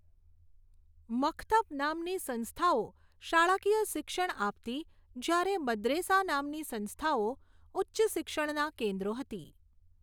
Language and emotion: Gujarati, neutral